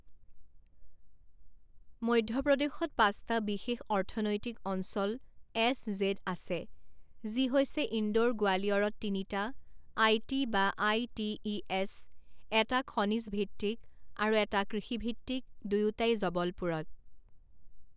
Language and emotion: Assamese, neutral